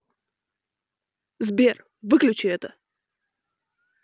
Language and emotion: Russian, angry